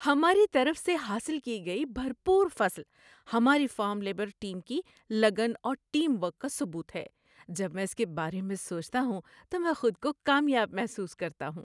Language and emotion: Urdu, happy